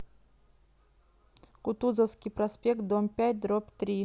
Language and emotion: Russian, neutral